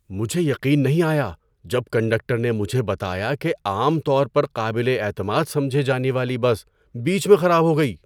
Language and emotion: Urdu, surprised